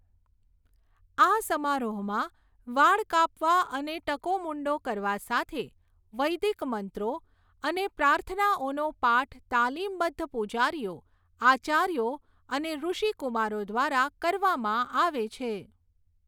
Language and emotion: Gujarati, neutral